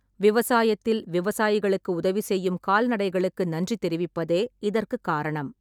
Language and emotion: Tamil, neutral